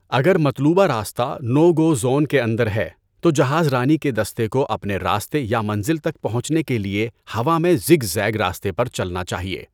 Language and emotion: Urdu, neutral